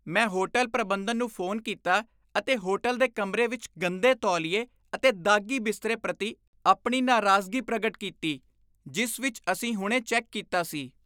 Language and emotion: Punjabi, disgusted